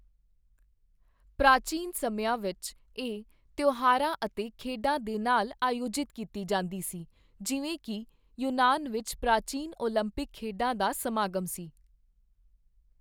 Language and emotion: Punjabi, neutral